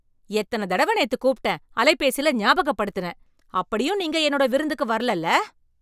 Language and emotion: Tamil, angry